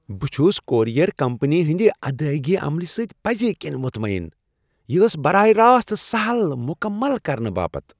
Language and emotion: Kashmiri, happy